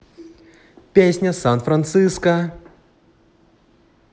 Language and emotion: Russian, positive